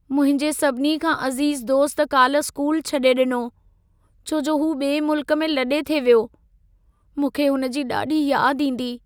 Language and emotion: Sindhi, sad